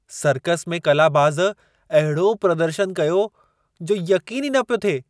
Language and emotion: Sindhi, surprised